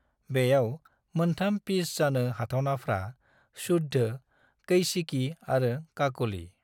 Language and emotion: Bodo, neutral